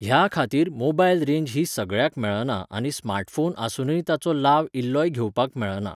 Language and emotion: Goan Konkani, neutral